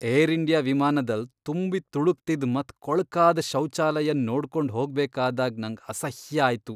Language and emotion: Kannada, disgusted